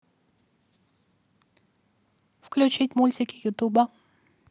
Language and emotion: Russian, neutral